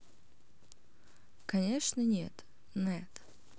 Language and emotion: Russian, neutral